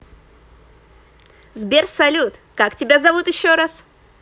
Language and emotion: Russian, positive